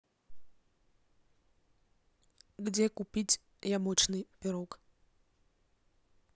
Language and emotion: Russian, neutral